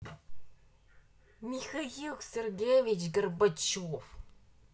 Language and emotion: Russian, angry